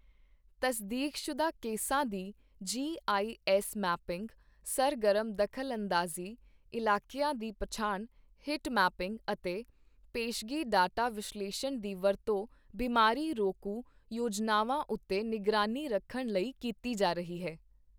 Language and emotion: Punjabi, neutral